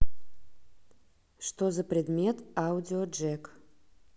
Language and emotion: Russian, neutral